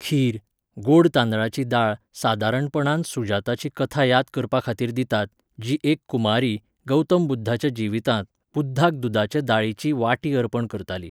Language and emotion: Goan Konkani, neutral